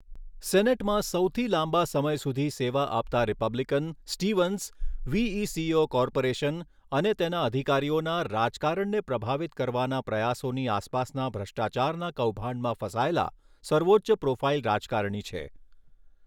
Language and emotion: Gujarati, neutral